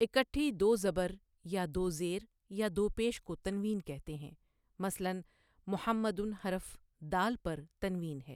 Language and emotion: Urdu, neutral